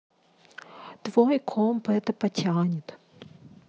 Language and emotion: Russian, angry